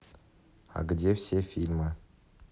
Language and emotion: Russian, neutral